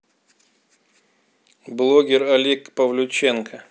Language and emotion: Russian, neutral